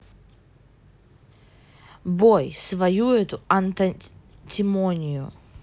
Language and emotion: Russian, neutral